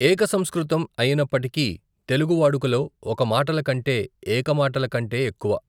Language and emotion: Telugu, neutral